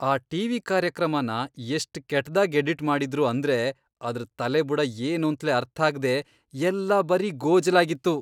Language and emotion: Kannada, disgusted